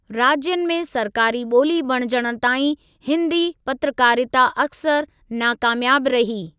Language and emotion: Sindhi, neutral